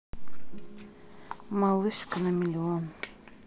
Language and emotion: Russian, neutral